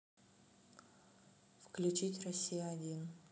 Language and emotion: Russian, neutral